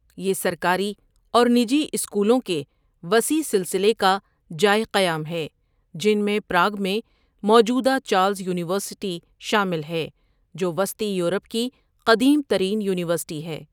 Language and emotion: Urdu, neutral